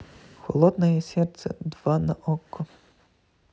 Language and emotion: Russian, neutral